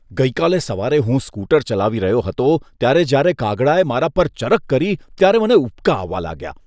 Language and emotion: Gujarati, disgusted